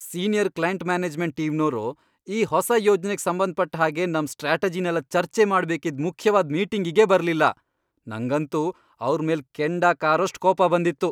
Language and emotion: Kannada, angry